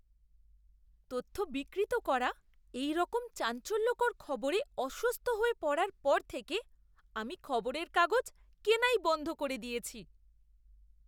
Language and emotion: Bengali, disgusted